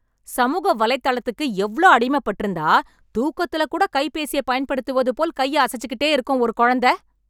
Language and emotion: Tamil, angry